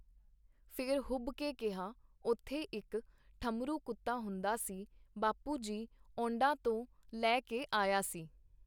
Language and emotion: Punjabi, neutral